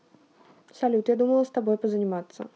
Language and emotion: Russian, neutral